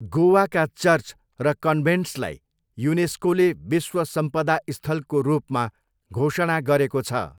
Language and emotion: Nepali, neutral